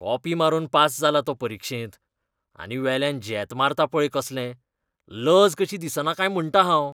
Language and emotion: Goan Konkani, disgusted